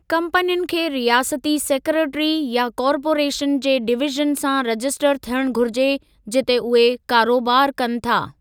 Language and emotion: Sindhi, neutral